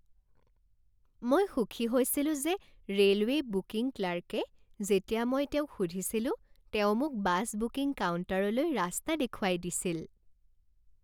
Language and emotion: Assamese, happy